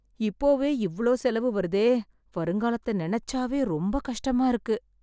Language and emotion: Tamil, sad